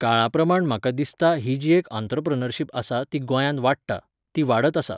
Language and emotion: Goan Konkani, neutral